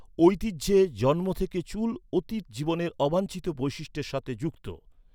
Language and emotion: Bengali, neutral